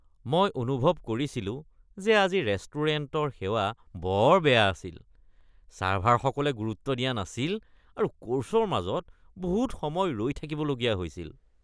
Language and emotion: Assamese, disgusted